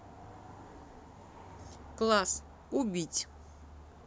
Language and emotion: Russian, neutral